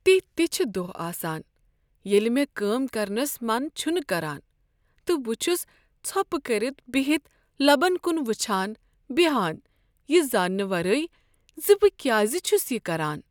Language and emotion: Kashmiri, sad